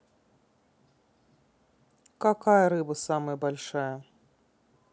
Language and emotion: Russian, neutral